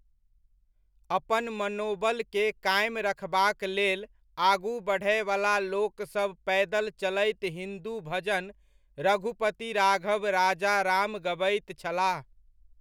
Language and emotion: Maithili, neutral